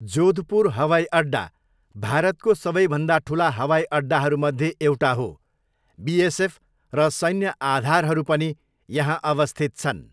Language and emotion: Nepali, neutral